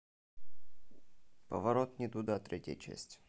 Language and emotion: Russian, neutral